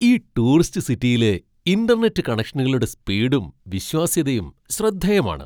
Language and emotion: Malayalam, surprised